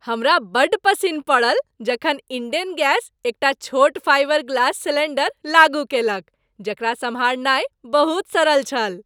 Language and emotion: Maithili, happy